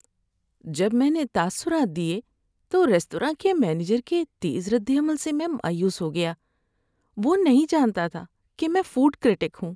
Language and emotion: Urdu, sad